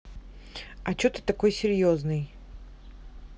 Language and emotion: Russian, neutral